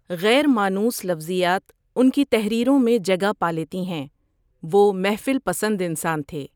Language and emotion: Urdu, neutral